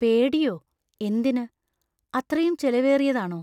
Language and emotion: Malayalam, fearful